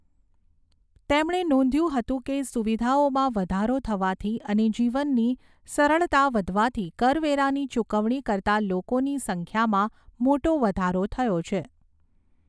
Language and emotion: Gujarati, neutral